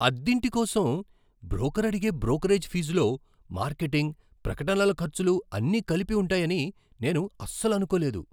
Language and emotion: Telugu, surprised